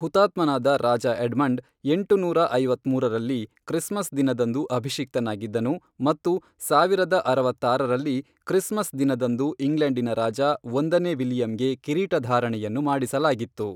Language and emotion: Kannada, neutral